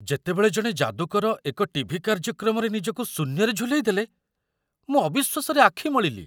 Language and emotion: Odia, surprised